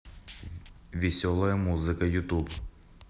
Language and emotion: Russian, neutral